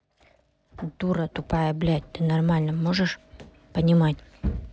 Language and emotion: Russian, angry